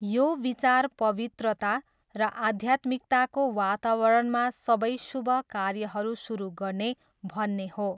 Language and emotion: Nepali, neutral